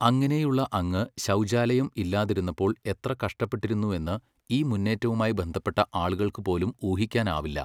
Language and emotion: Malayalam, neutral